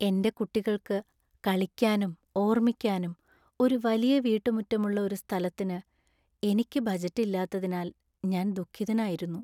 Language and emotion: Malayalam, sad